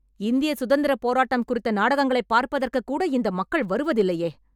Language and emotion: Tamil, angry